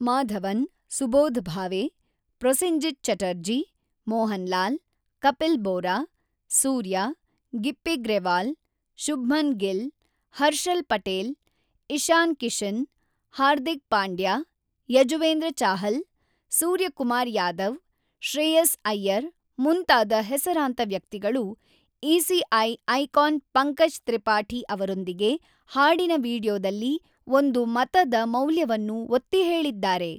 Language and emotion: Kannada, neutral